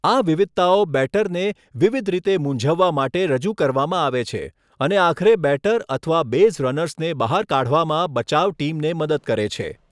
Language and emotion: Gujarati, neutral